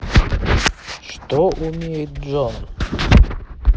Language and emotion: Russian, neutral